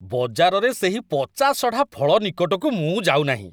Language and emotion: Odia, disgusted